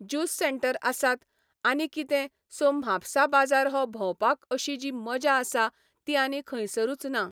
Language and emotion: Goan Konkani, neutral